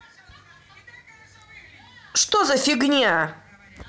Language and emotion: Russian, angry